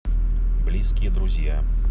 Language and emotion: Russian, neutral